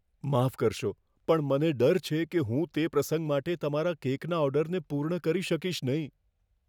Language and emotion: Gujarati, fearful